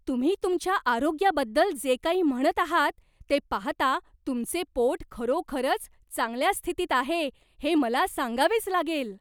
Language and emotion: Marathi, surprised